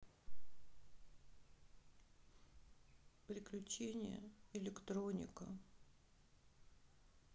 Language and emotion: Russian, sad